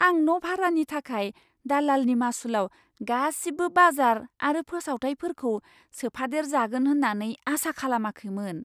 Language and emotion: Bodo, surprised